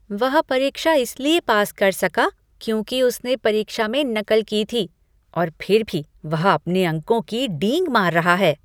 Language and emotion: Hindi, disgusted